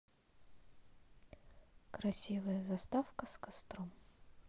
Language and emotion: Russian, neutral